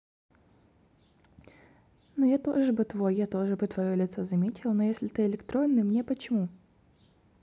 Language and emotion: Russian, neutral